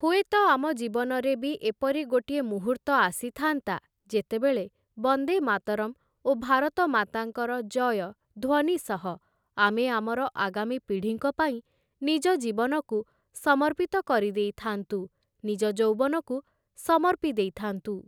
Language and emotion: Odia, neutral